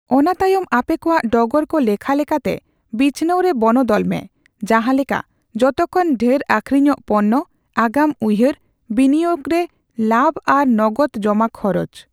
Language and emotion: Santali, neutral